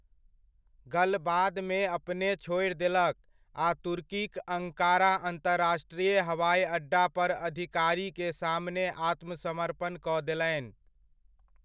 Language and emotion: Maithili, neutral